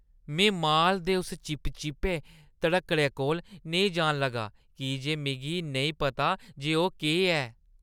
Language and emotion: Dogri, disgusted